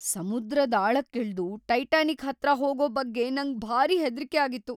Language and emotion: Kannada, fearful